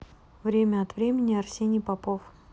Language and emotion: Russian, neutral